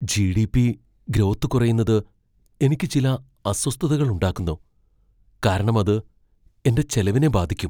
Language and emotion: Malayalam, fearful